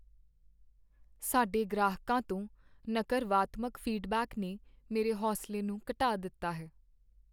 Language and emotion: Punjabi, sad